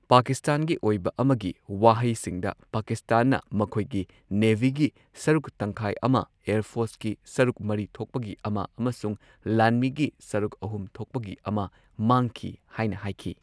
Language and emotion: Manipuri, neutral